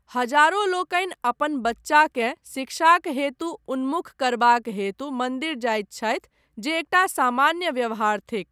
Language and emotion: Maithili, neutral